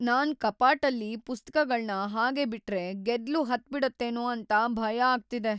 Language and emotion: Kannada, fearful